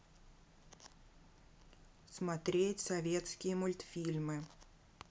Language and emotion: Russian, neutral